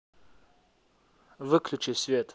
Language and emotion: Russian, neutral